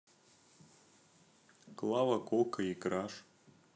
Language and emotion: Russian, neutral